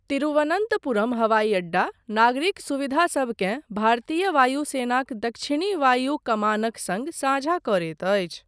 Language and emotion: Maithili, neutral